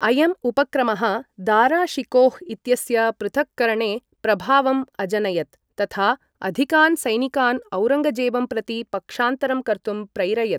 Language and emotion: Sanskrit, neutral